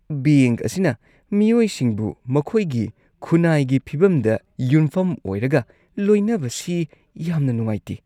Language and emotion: Manipuri, disgusted